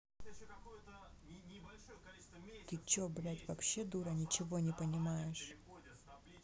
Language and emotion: Russian, neutral